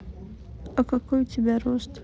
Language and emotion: Russian, neutral